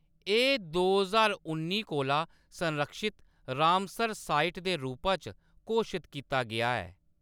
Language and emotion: Dogri, neutral